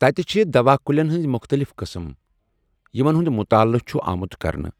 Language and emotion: Kashmiri, neutral